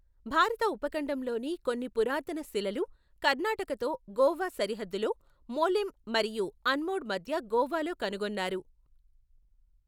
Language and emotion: Telugu, neutral